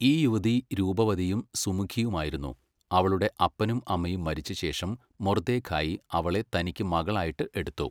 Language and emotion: Malayalam, neutral